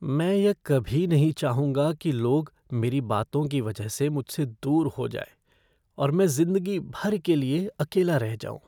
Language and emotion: Hindi, fearful